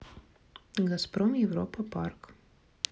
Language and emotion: Russian, neutral